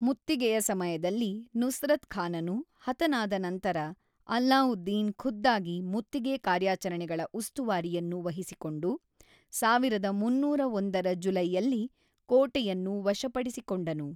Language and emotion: Kannada, neutral